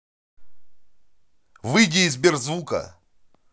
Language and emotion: Russian, angry